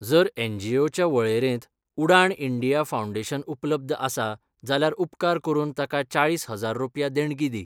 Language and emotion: Goan Konkani, neutral